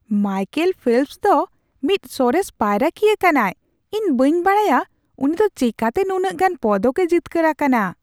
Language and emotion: Santali, surprised